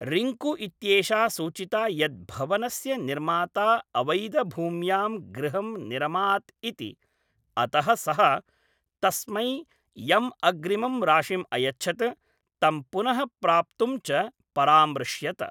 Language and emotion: Sanskrit, neutral